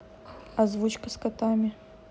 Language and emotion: Russian, neutral